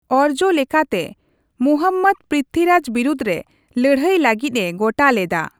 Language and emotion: Santali, neutral